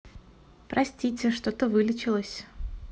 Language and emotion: Russian, neutral